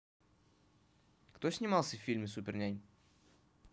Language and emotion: Russian, neutral